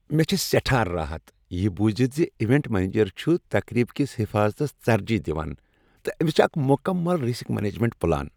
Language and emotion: Kashmiri, happy